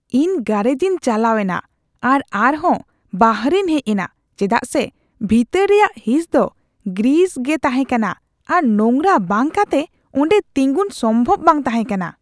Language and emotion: Santali, disgusted